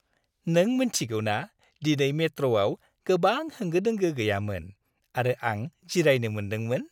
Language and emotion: Bodo, happy